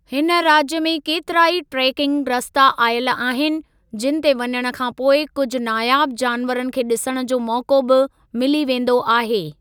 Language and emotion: Sindhi, neutral